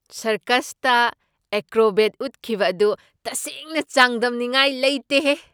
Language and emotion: Manipuri, surprised